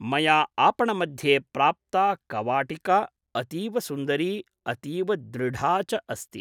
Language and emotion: Sanskrit, neutral